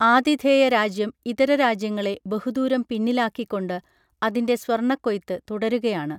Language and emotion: Malayalam, neutral